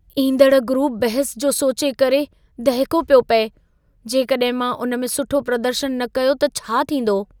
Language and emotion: Sindhi, fearful